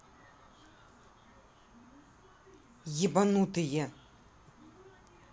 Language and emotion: Russian, angry